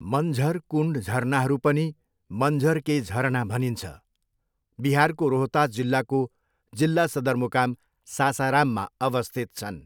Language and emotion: Nepali, neutral